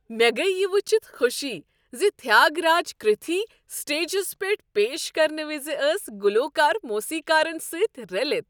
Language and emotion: Kashmiri, happy